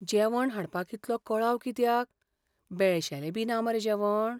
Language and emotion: Goan Konkani, fearful